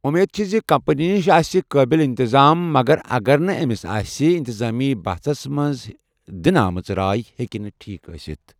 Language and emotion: Kashmiri, neutral